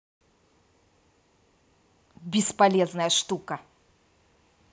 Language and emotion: Russian, angry